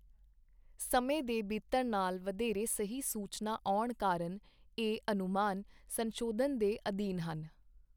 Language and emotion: Punjabi, neutral